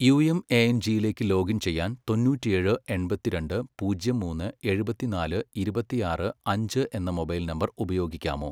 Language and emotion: Malayalam, neutral